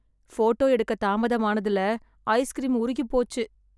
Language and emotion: Tamil, sad